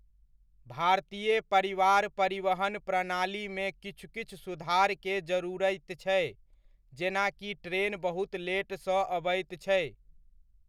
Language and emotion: Maithili, neutral